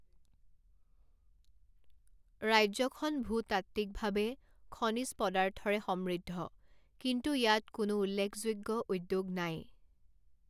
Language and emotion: Assamese, neutral